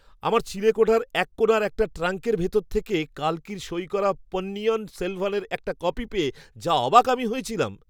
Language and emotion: Bengali, surprised